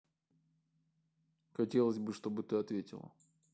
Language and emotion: Russian, neutral